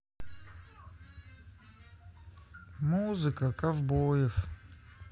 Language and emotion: Russian, sad